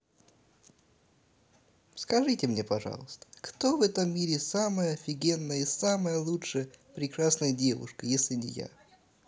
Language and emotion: Russian, positive